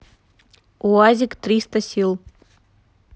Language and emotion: Russian, neutral